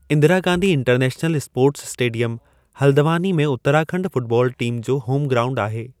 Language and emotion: Sindhi, neutral